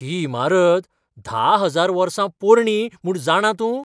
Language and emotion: Goan Konkani, surprised